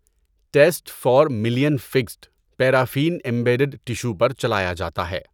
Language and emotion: Urdu, neutral